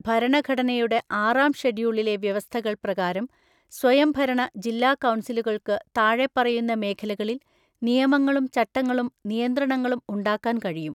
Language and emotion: Malayalam, neutral